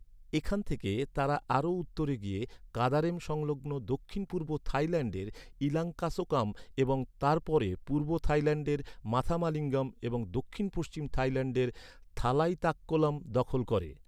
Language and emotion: Bengali, neutral